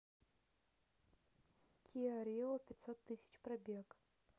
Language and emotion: Russian, neutral